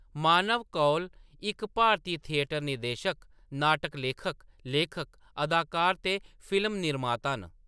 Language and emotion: Dogri, neutral